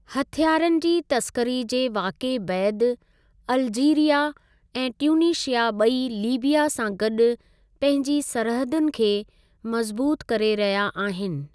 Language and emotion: Sindhi, neutral